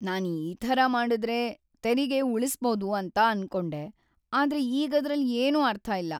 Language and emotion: Kannada, sad